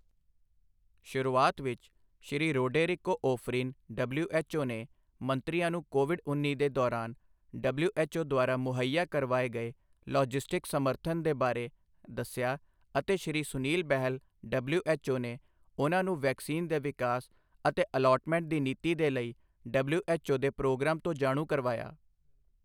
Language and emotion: Punjabi, neutral